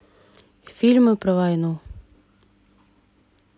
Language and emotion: Russian, neutral